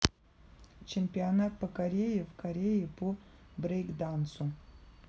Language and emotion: Russian, neutral